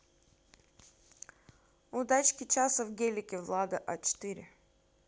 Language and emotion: Russian, neutral